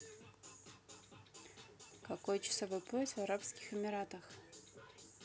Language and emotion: Russian, neutral